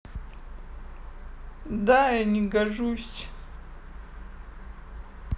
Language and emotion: Russian, sad